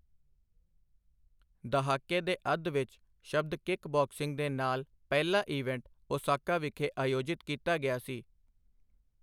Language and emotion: Punjabi, neutral